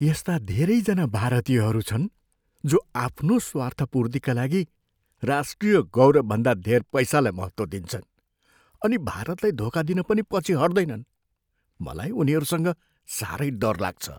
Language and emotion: Nepali, fearful